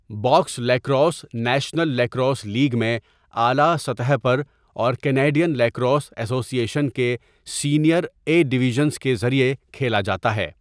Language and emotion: Urdu, neutral